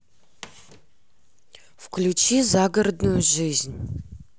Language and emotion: Russian, neutral